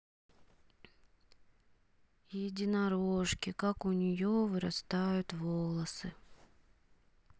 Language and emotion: Russian, sad